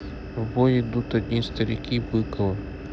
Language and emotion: Russian, neutral